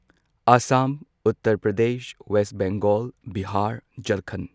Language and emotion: Manipuri, neutral